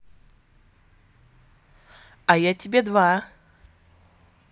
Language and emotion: Russian, positive